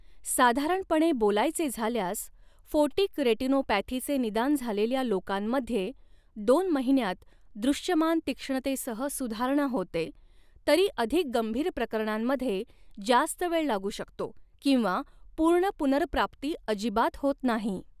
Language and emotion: Marathi, neutral